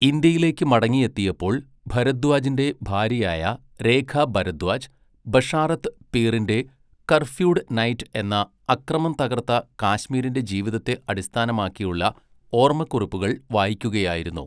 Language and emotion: Malayalam, neutral